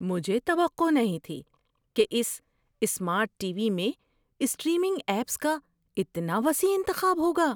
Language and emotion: Urdu, surprised